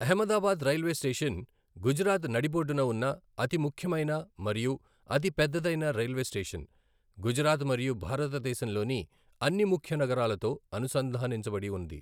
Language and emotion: Telugu, neutral